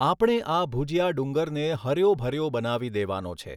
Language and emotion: Gujarati, neutral